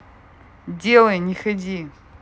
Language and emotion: Russian, angry